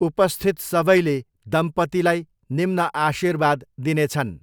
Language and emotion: Nepali, neutral